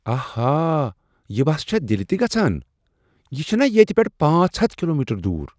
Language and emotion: Kashmiri, surprised